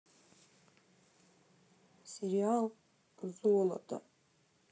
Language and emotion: Russian, sad